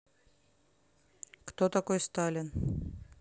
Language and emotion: Russian, neutral